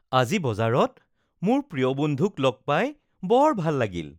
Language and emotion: Assamese, happy